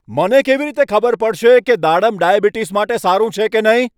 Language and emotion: Gujarati, angry